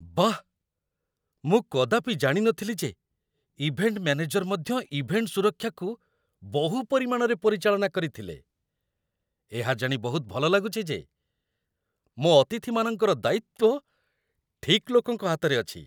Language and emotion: Odia, surprised